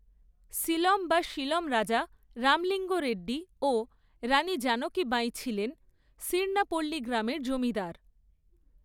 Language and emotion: Bengali, neutral